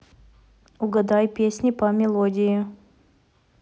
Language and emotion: Russian, neutral